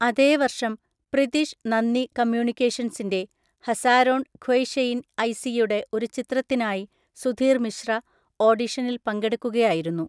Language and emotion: Malayalam, neutral